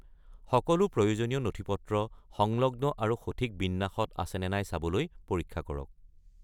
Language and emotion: Assamese, neutral